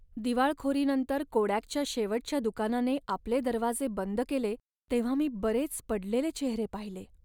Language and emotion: Marathi, sad